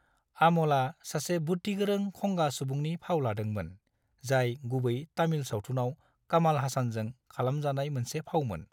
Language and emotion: Bodo, neutral